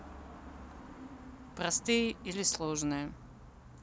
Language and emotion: Russian, neutral